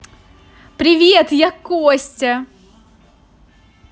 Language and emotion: Russian, positive